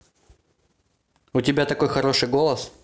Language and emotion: Russian, positive